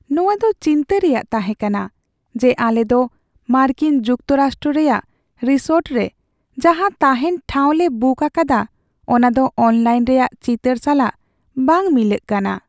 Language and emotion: Santali, sad